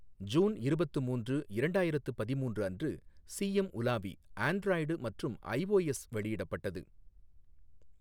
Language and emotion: Tamil, neutral